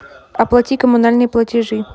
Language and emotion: Russian, neutral